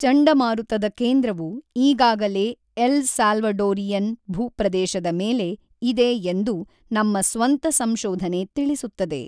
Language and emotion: Kannada, neutral